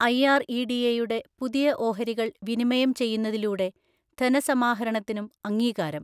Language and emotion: Malayalam, neutral